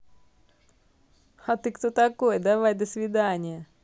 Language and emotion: Russian, positive